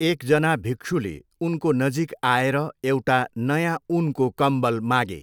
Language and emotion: Nepali, neutral